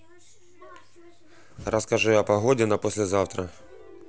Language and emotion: Russian, neutral